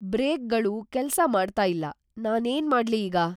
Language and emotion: Kannada, fearful